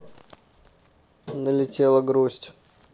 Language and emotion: Russian, neutral